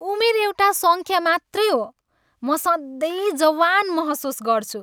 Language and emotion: Nepali, happy